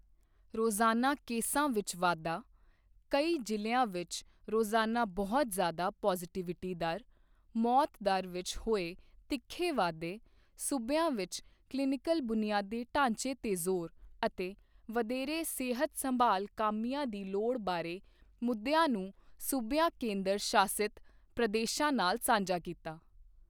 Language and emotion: Punjabi, neutral